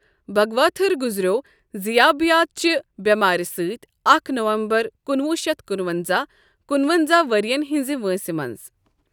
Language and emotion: Kashmiri, neutral